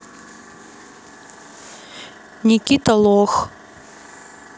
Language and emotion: Russian, neutral